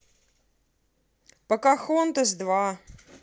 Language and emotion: Russian, neutral